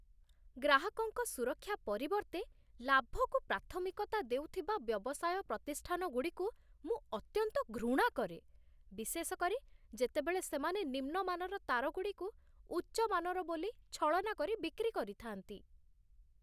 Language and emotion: Odia, disgusted